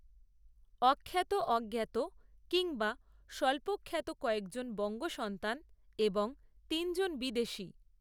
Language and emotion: Bengali, neutral